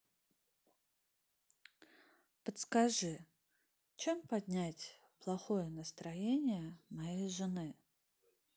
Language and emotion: Russian, sad